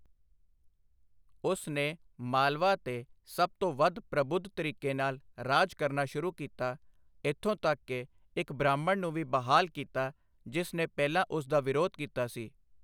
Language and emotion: Punjabi, neutral